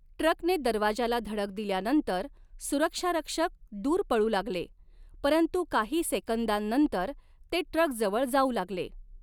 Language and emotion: Marathi, neutral